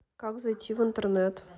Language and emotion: Russian, neutral